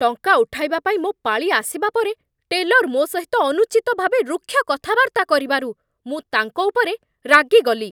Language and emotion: Odia, angry